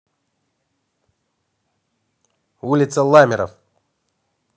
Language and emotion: Russian, neutral